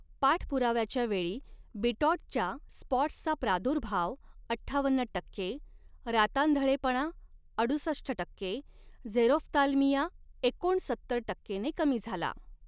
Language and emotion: Marathi, neutral